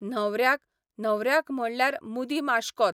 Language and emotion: Goan Konkani, neutral